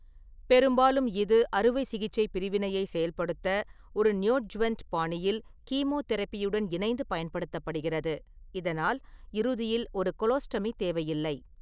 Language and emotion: Tamil, neutral